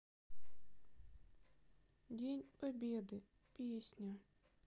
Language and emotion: Russian, sad